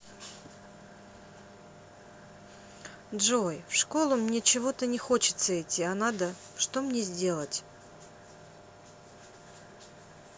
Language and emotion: Russian, neutral